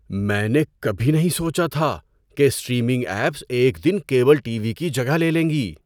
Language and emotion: Urdu, surprised